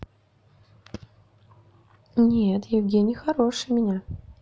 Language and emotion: Russian, neutral